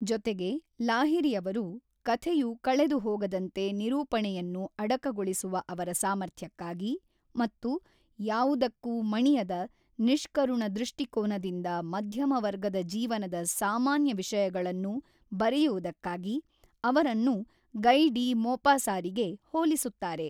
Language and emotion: Kannada, neutral